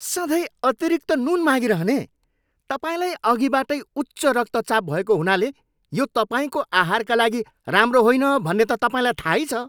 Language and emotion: Nepali, angry